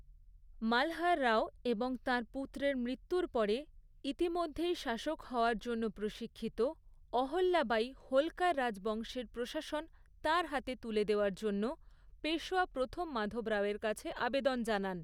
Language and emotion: Bengali, neutral